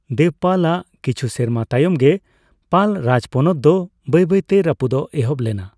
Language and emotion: Santali, neutral